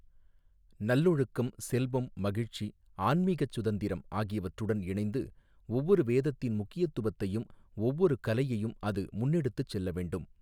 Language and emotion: Tamil, neutral